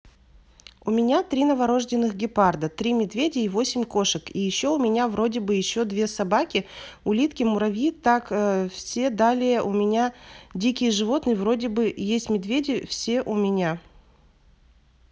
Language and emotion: Russian, neutral